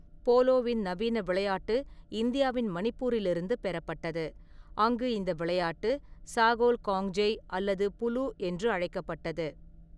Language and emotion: Tamil, neutral